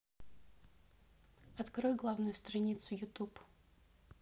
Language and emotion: Russian, neutral